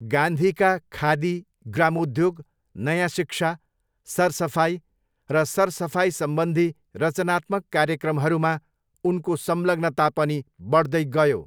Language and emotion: Nepali, neutral